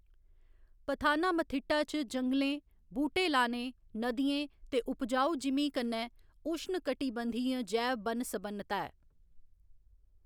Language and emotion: Dogri, neutral